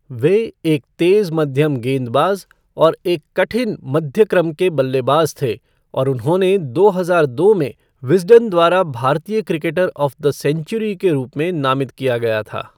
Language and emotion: Hindi, neutral